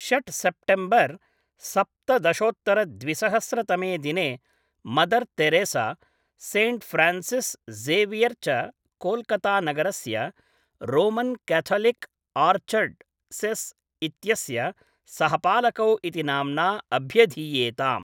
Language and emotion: Sanskrit, neutral